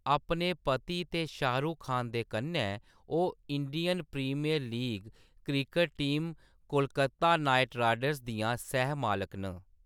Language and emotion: Dogri, neutral